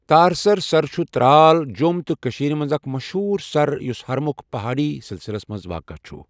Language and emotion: Kashmiri, neutral